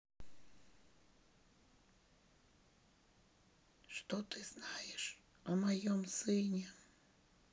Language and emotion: Russian, sad